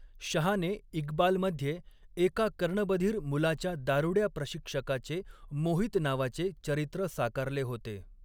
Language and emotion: Marathi, neutral